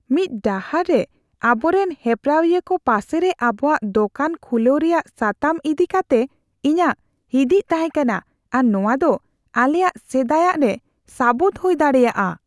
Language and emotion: Santali, fearful